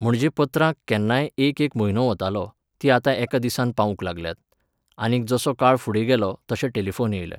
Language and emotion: Goan Konkani, neutral